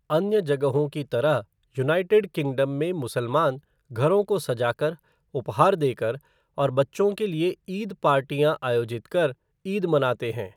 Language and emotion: Hindi, neutral